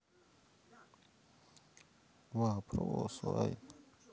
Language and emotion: Russian, sad